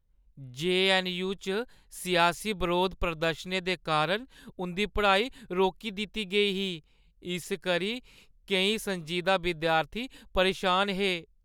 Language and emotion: Dogri, sad